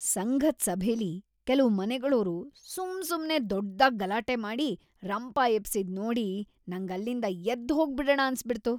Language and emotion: Kannada, disgusted